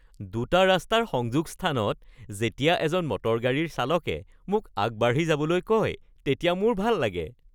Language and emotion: Assamese, happy